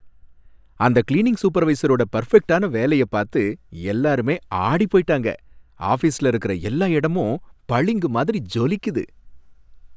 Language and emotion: Tamil, happy